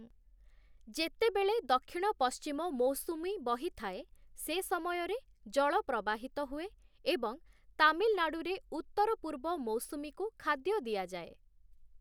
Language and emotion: Odia, neutral